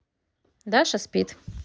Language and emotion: Russian, neutral